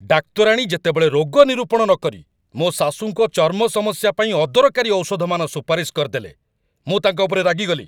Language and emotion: Odia, angry